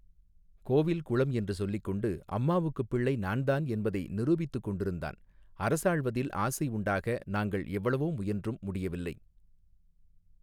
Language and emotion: Tamil, neutral